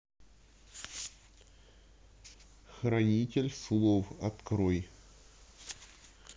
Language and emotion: Russian, neutral